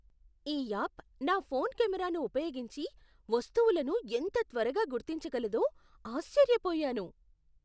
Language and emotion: Telugu, surprised